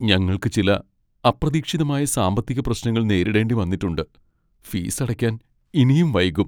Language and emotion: Malayalam, sad